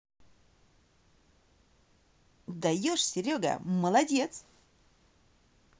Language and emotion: Russian, positive